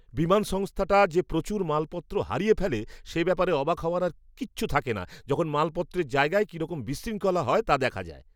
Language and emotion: Bengali, disgusted